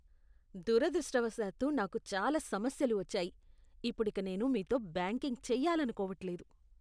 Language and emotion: Telugu, disgusted